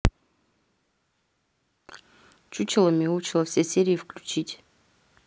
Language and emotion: Russian, neutral